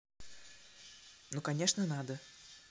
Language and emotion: Russian, neutral